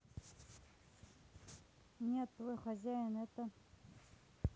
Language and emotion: Russian, neutral